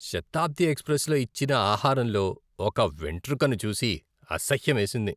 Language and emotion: Telugu, disgusted